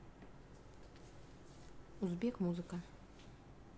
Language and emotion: Russian, neutral